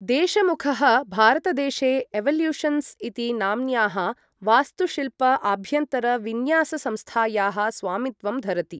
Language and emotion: Sanskrit, neutral